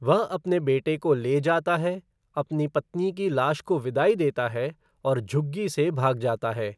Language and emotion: Hindi, neutral